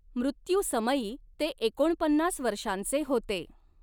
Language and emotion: Marathi, neutral